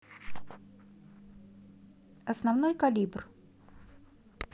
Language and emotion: Russian, neutral